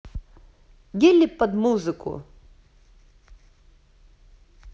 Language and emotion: Russian, positive